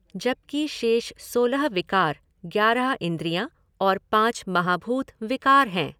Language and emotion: Hindi, neutral